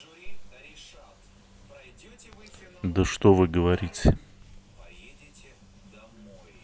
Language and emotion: Russian, neutral